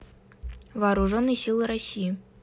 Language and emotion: Russian, neutral